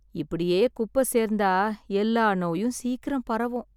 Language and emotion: Tamil, sad